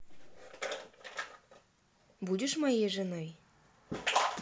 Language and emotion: Russian, neutral